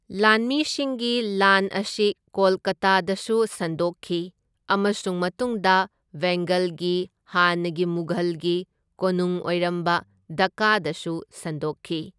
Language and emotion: Manipuri, neutral